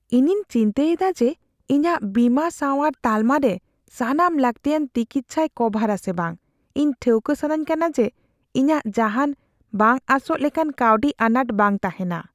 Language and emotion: Santali, fearful